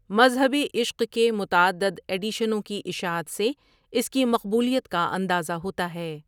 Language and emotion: Urdu, neutral